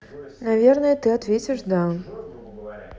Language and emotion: Russian, neutral